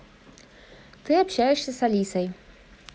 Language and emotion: Russian, neutral